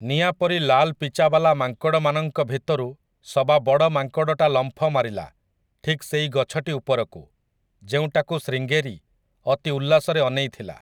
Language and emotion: Odia, neutral